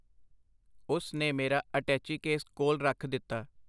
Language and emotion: Punjabi, neutral